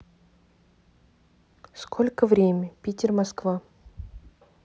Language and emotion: Russian, neutral